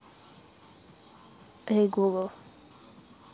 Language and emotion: Russian, neutral